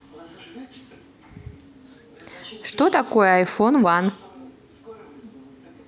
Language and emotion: Russian, neutral